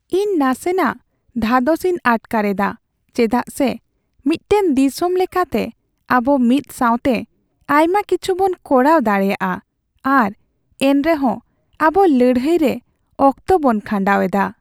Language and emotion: Santali, sad